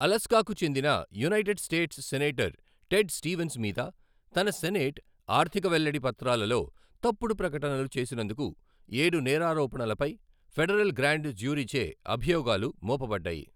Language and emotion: Telugu, neutral